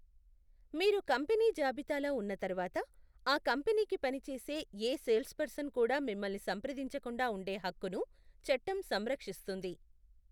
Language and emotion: Telugu, neutral